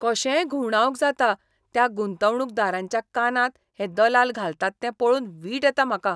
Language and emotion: Goan Konkani, disgusted